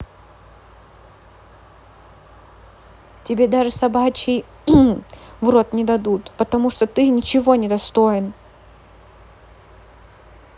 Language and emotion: Russian, angry